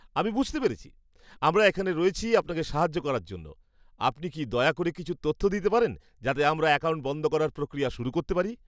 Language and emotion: Bengali, happy